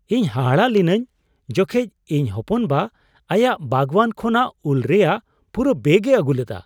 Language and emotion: Santali, surprised